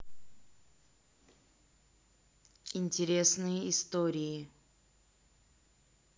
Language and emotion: Russian, neutral